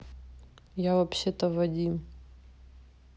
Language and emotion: Russian, neutral